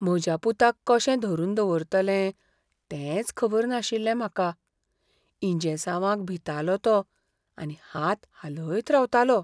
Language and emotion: Goan Konkani, fearful